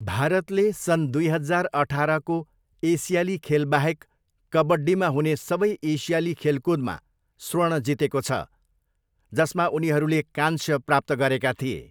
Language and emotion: Nepali, neutral